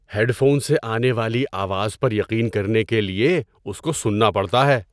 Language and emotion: Urdu, surprised